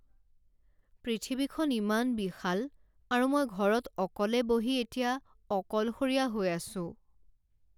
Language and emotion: Assamese, sad